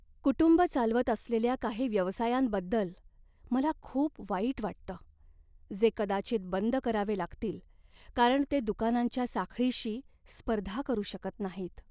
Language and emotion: Marathi, sad